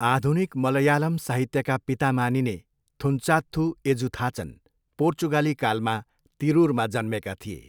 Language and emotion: Nepali, neutral